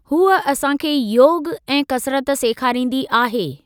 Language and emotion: Sindhi, neutral